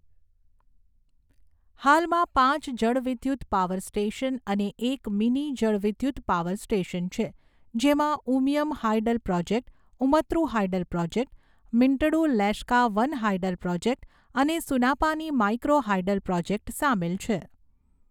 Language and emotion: Gujarati, neutral